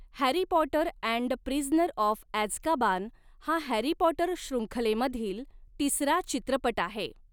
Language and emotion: Marathi, neutral